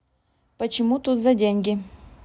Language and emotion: Russian, neutral